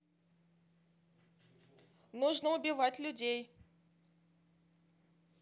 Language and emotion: Russian, neutral